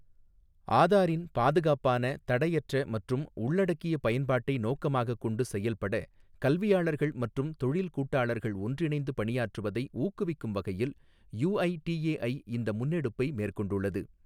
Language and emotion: Tamil, neutral